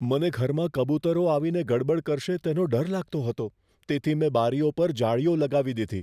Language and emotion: Gujarati, fearful